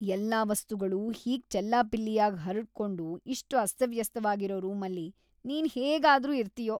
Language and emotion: Kannada, disgusted